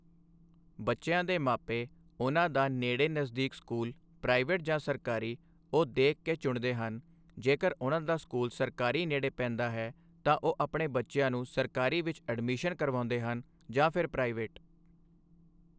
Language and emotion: Punjabi, neutral